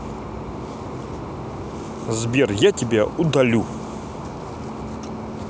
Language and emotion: Russian, angry